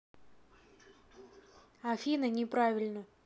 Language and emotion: Russian, neutral